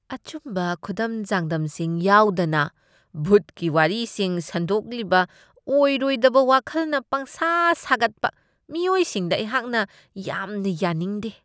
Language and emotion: Manipuri, disgusted